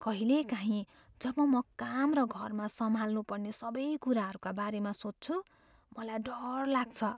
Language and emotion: Nepali, fearful